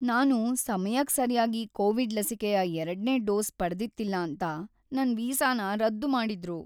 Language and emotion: Kannada, sad